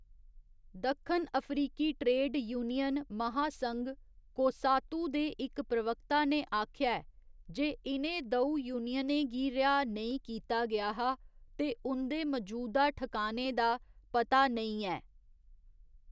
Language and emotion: Dogri, neutral